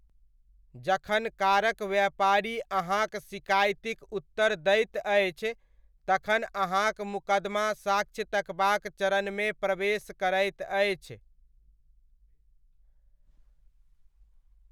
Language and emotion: Maithili, neutral